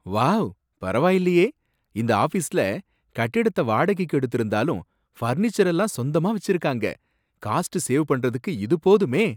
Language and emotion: Tamil, surprised